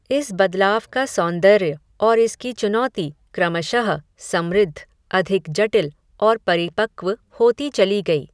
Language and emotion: Hindi, neutral